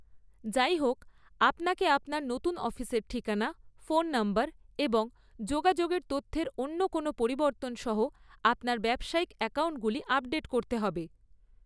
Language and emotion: Bengali, neutral